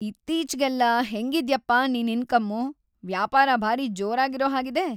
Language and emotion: Kannada, happy